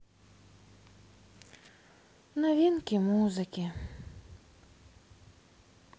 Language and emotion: Russian, sad